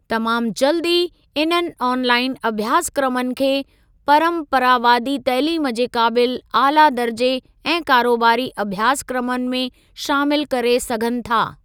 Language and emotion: Sindhi, neutral